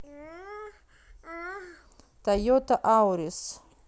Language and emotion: Russian, neutral